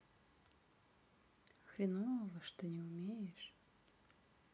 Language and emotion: Russian, sad